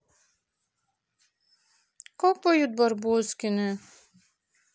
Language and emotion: Russian, sad